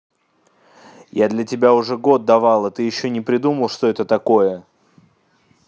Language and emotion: Russian, angry